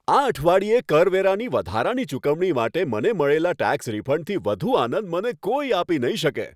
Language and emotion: Gujarati, happy